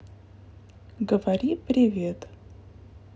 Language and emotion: Russian, neutral